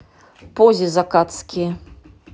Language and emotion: Russian, neutral